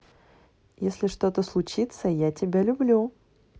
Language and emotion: Russian, positive